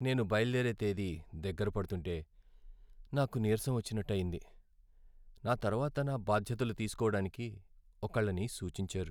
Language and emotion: Telugu, sad